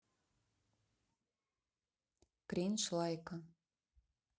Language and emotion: Russian, neutral